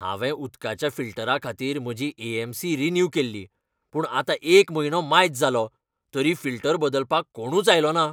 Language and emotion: Goan Konkani, angry